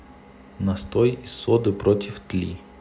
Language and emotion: Russian, neutral